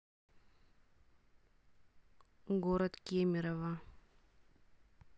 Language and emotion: Russian, neutral